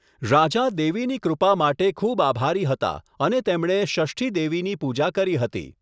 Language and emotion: Gujarati, neutral